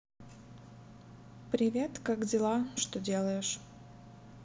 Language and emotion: Russian, neutral